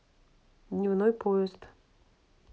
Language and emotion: Russian, neutral